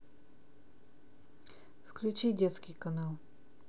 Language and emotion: Russian, neutral